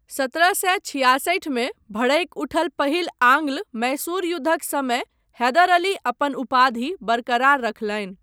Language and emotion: Maithili, neutral